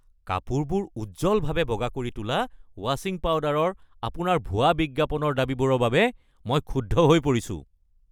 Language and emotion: Assamese, angry